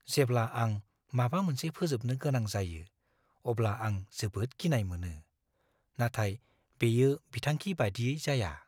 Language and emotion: Bodo, fearful